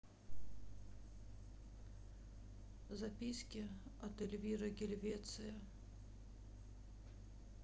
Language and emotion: Russian, sad